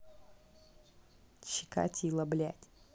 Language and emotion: Russian, angry